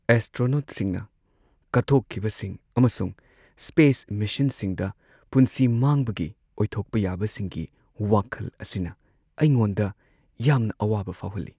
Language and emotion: Manipuri, sad